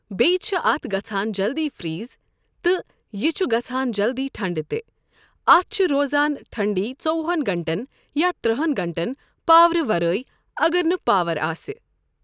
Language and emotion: Kashmiri, neutral